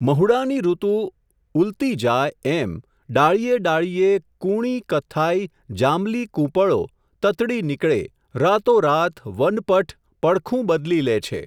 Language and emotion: Gujarati, neutral